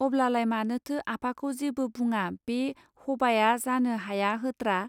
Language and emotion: Bodo, neutral